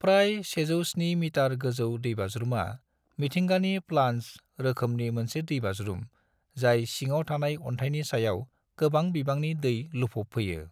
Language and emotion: Bodo, neutral